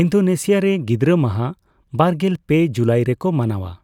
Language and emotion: Santali, neutral